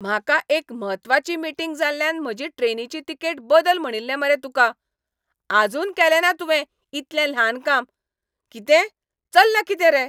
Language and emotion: Goan Konkani, angry